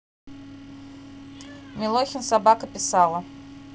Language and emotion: Russian, neutral